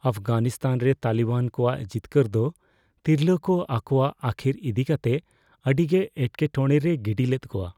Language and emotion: Santali, fearful